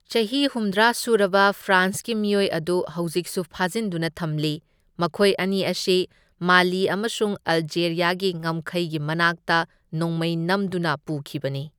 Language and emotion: Manipuri, neutral